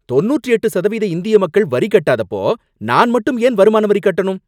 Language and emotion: Tamil, angry